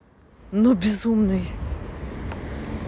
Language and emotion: Russian, neutral